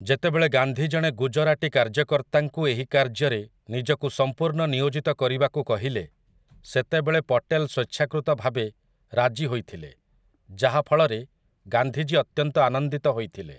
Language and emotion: Odia, neutral